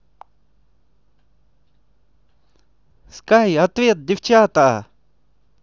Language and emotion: Russian, positive